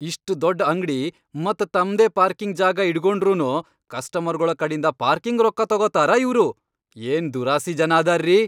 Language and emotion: Kannada, angry